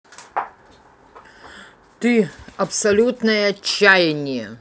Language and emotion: Russian, angry